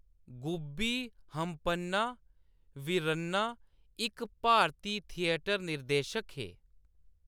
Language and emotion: Dogri, neutral